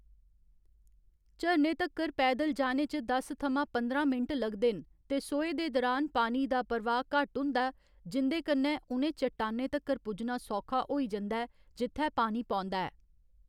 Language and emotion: Dogri, neutral